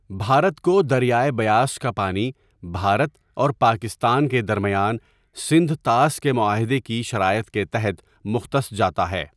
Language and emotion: Urdu, neutral